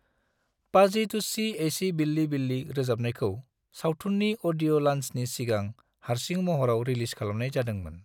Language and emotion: Bodo, neutral